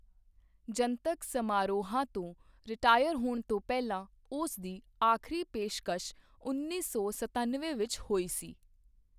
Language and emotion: Punjabi, neutral